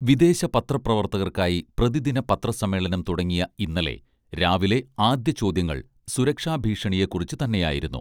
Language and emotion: Malayalam, neutral